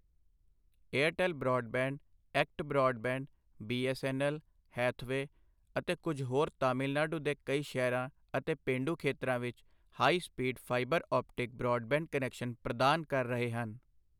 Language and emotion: Punjabi, neutral